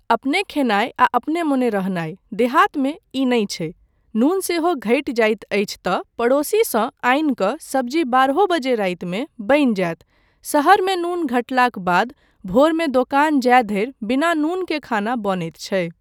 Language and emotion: Maithili, neutral